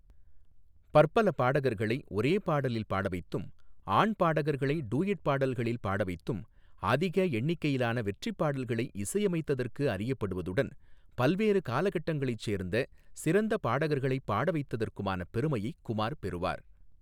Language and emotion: Tamil, neutral